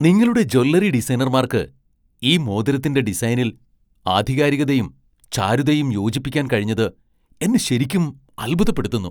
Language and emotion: Malayalam, surprised